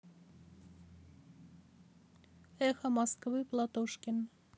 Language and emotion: Russian, neutral